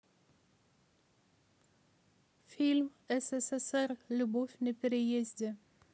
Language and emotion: Russian, neutral